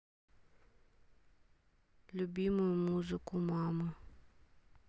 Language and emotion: Russian, sad